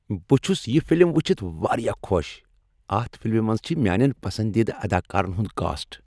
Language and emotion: Kashmiri, happy